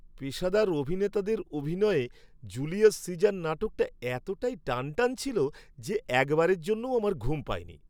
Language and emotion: Bengali, happy